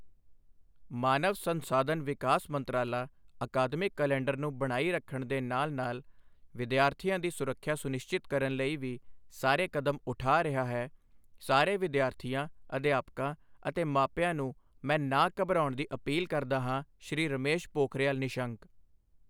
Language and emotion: Punjabi, neutral